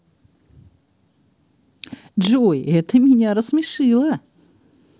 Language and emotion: Russian, positive